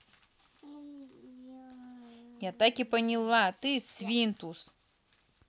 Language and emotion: Russian, angry